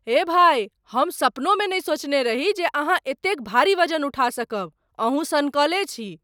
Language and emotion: Maithili, surprised